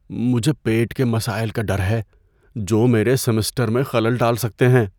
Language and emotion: Urdu, fearful